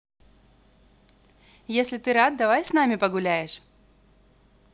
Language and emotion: Russian, positive